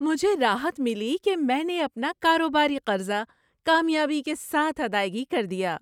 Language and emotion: Urdu, happy